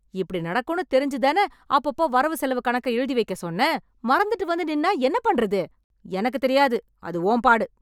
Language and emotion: Tamil, angry